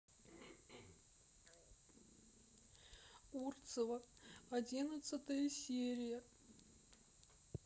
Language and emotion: Russian, sad